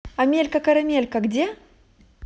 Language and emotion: Russian, positive